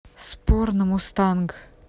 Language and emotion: Russian, neutral